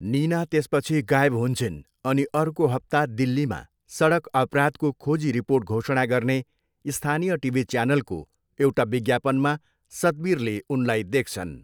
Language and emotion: Nepali, neutral